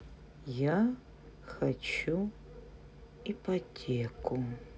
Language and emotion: Russian, neutral